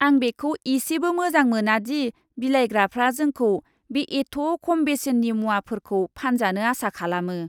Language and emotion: Bodo, disgusted